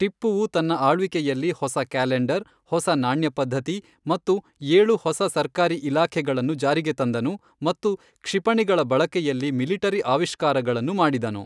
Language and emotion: Kannada, neutral